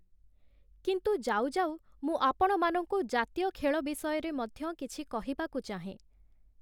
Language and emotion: Odia, neutral